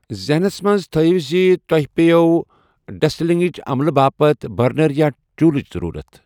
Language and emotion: Kashmiri, neutral